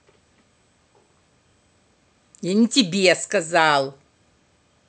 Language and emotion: Russian, angry